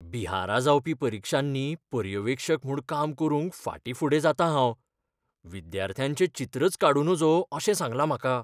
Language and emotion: Goan Konkani, fearful